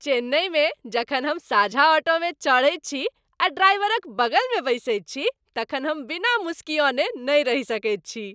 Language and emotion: Maithili, happy